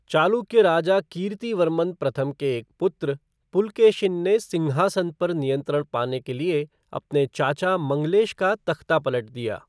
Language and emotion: Hindi, neutral